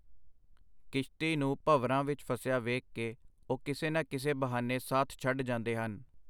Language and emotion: Punjabi, neutral